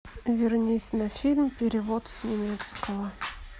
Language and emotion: Russian, neutral